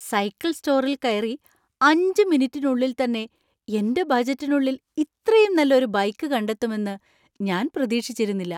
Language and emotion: Malayalam, surprised